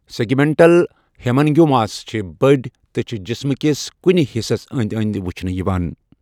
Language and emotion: Kashmiri, neutral